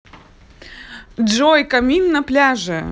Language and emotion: Russian, positive